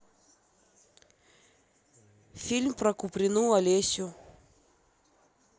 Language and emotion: Russian, neutral